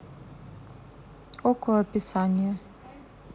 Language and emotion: Russian, neutral